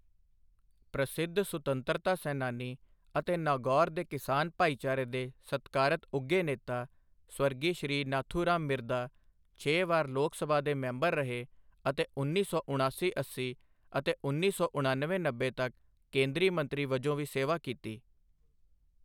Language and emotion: Punjabi, neutral